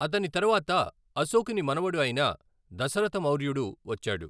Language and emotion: Telugu, neutral